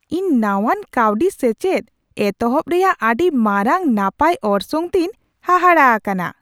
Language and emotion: Santali, surprised